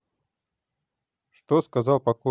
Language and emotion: Russian, neutral